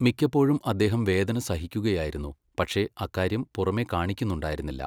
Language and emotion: Malayalam, neutral